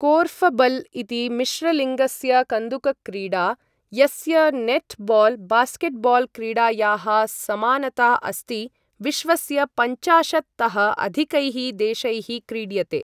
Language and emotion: Sanskrit, neutral